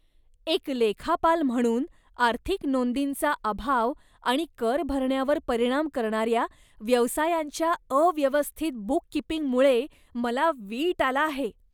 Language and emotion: Marathi, disgusted